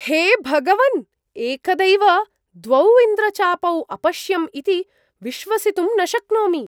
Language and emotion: Sanskrit, surprised